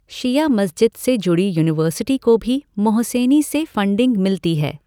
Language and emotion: Hindi, neutral